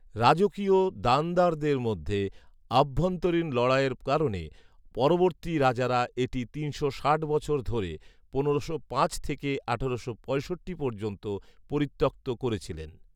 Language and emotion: Bengali, neutral